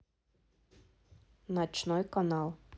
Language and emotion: Russian, neutral